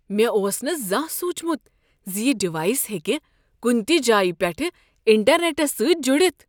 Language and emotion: Kashmiri, surprised